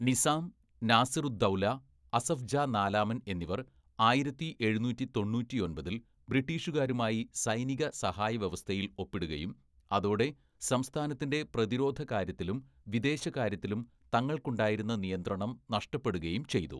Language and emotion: Malayalam, neutral